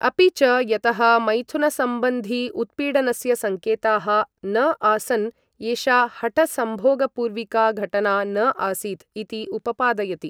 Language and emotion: Sanskrit, neutral